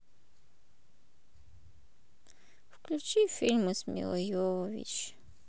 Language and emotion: Russian, sad